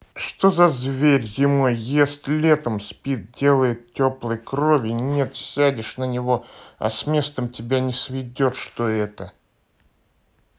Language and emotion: Russian, neutral